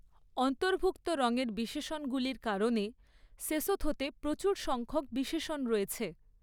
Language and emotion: Bengali, neutral